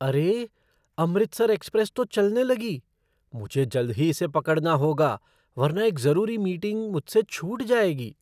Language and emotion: Hindi, surprised